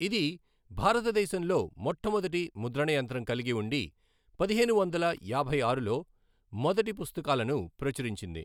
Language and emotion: Telugu, neutral